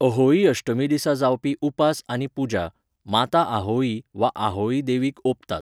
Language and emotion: Goan Konkani, neutral